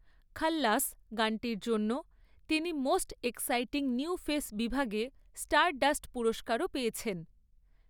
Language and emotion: Bengali, neutral